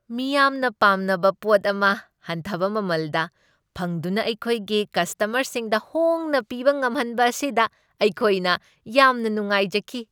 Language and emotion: Manipuri, happy